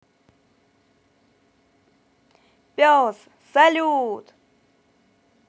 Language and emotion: Russian, positive